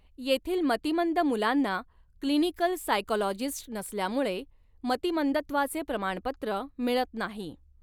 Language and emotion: Marathi, neutral